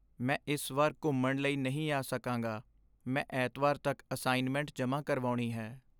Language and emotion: Punjabi, sad